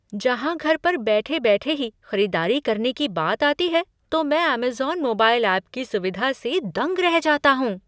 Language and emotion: Hindi, surprised